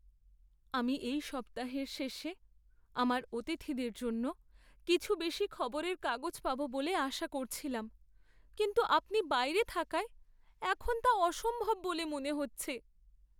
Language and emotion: Bengali, sad